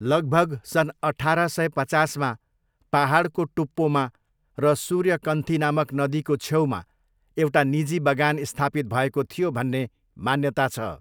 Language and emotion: Nepali, neutral